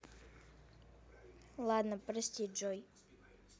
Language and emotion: Russian, neutral